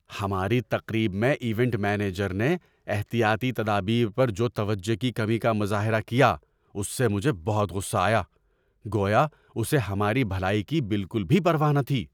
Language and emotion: Urdu, angry